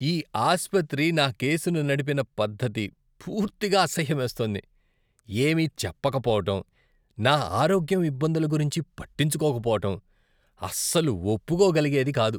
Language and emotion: Telugu, disgusted